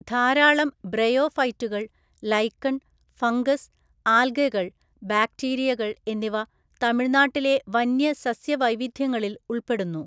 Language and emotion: Malayalam, neutral